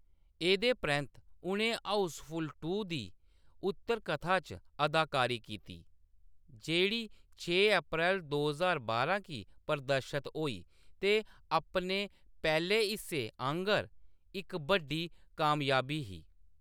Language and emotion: Dogri, neutral